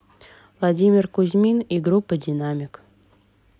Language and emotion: Russian, neutral